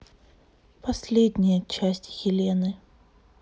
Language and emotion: Russian, sad